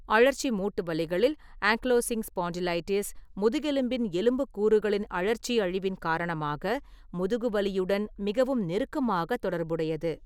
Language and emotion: Tamil, neutral